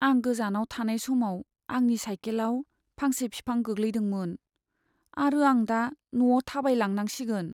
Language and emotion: Bodo, sad